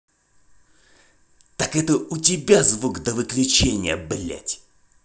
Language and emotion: Russian, angry